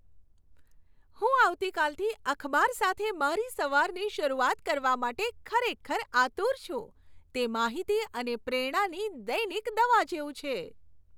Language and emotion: Gujarati, happy